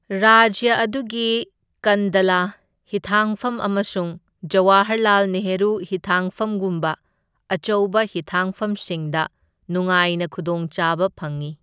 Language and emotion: Manipuri, neutral